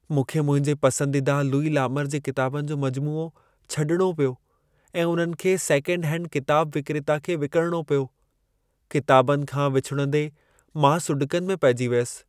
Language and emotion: Sindhi, sad